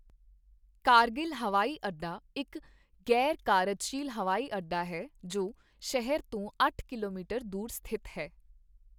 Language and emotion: Punjabi, neutral